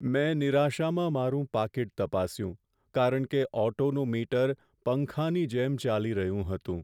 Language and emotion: Gujarati, sad